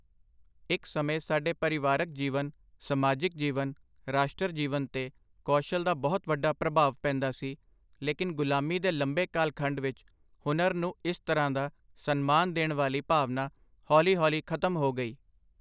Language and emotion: Punjabi, neutral